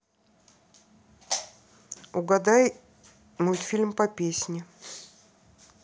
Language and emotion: Russian, neutral